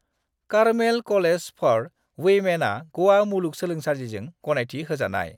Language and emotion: Bodo, neutral